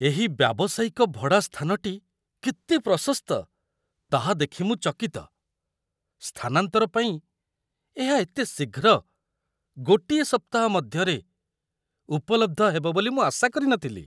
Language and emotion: Odia, surprised